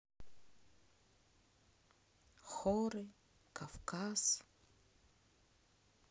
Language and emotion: Russian, sad